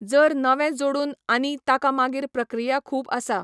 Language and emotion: Goan Konkani, neutral